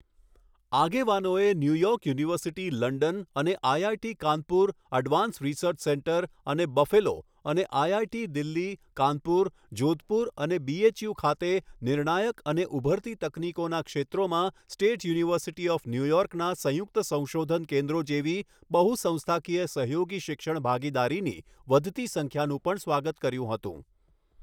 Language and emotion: Gujarati, neutral